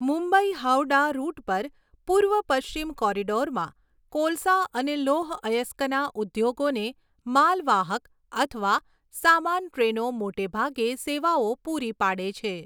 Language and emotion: Gujarati, neutral